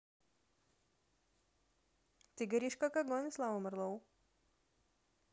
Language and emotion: Russian, positive